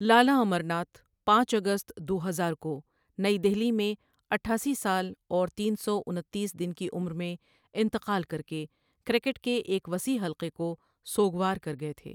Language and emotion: Urdu, neutral